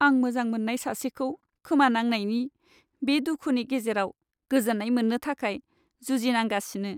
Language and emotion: Bodo, sad